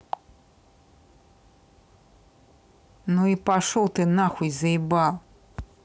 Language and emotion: Russian, angry